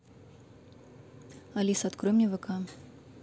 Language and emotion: Russian, neutral